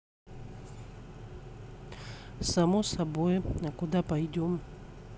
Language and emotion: Russian, neutral